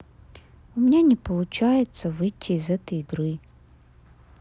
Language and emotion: Russian, sad